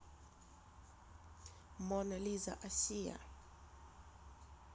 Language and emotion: Russian, neutral